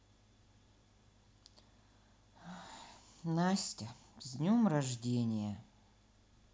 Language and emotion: Russian, sad